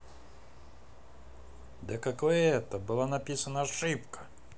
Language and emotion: Russian, angry